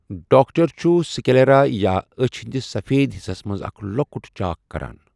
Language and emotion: Kashmiri, neutral